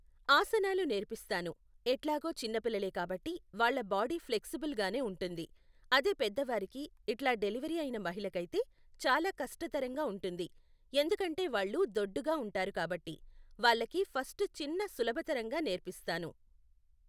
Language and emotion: Telugu, neutral